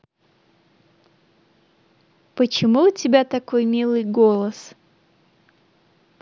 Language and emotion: Russian, positive